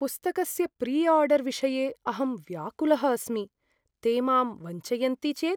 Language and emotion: Sanskrit, fearful